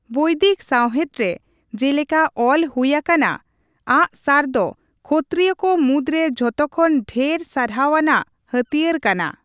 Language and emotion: Santali, neutral